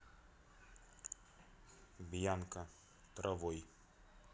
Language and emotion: Russian, neutral